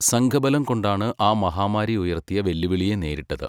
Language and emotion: Malayalam, neutral